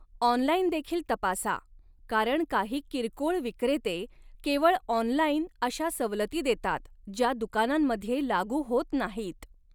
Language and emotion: Marathi, neutral